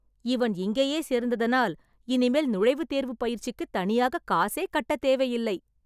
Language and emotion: Tamil, happy